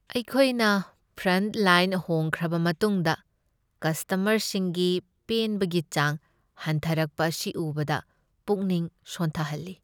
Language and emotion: Manipuri, sad